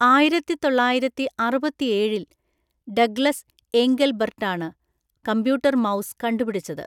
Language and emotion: Malayalam, neutral